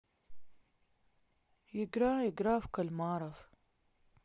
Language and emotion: Russian, sad